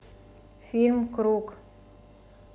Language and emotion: Russian, neutral